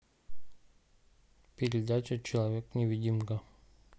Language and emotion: Russian, neutral